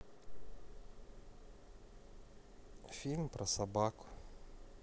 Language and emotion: Russian, neutral